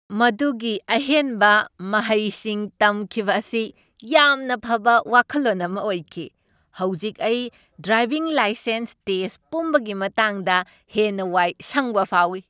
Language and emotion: Manipuri, happy